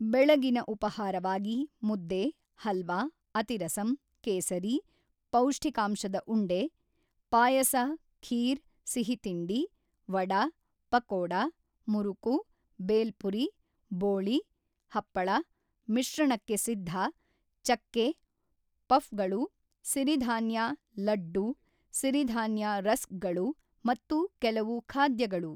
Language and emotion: Kannada, neutral